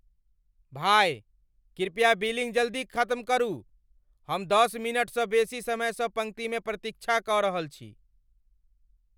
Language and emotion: Maithili, angry